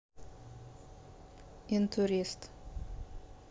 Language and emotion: Russian, neutral